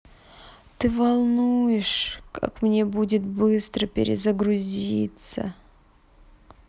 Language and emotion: Russian, sad